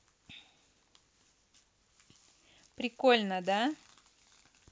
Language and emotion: Russian, positive